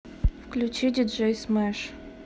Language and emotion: Russian, neutral